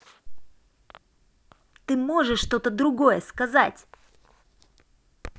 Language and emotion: Russian, angry